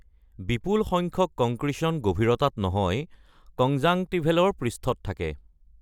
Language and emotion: Assamese, neutral